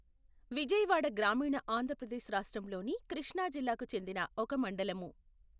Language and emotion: Telugu, neutral